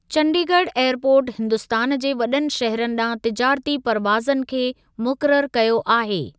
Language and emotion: Sindhi, neutral